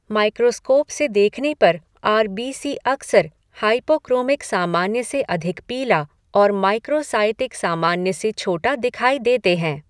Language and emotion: Hindi, neutral